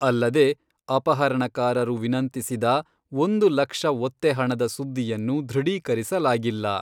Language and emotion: Kannada, neutral